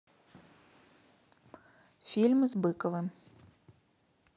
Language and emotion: Russian, neutral